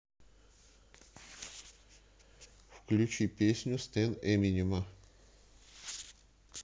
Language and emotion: Russian, neutral